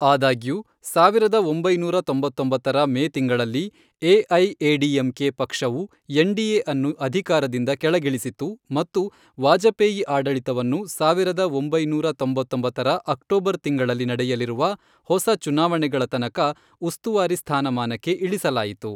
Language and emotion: Kannada, neutral